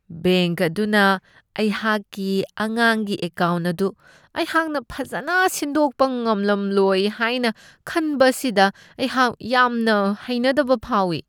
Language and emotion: Manipuri, disgusted